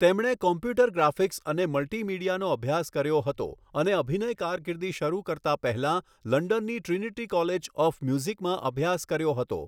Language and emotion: Gujarati, neutral